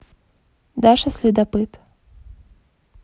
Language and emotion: Russian, neutral